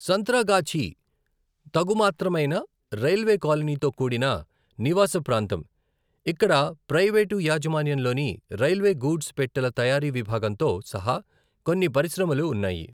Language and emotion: Telugu, neutral